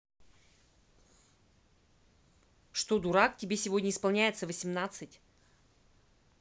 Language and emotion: Russian, angry